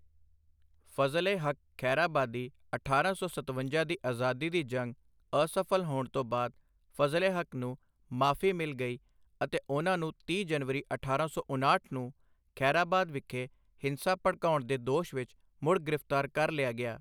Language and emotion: Punjabi, neutral